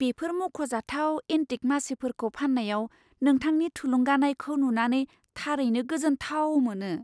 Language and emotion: Bodo, surprised